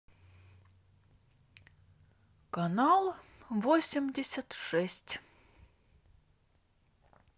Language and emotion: Russian, neutral